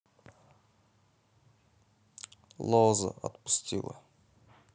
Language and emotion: Russian, neutral